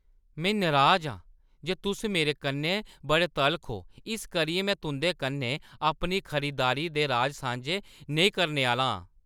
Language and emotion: Dogri, angry